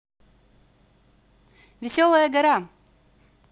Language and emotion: Russian, positive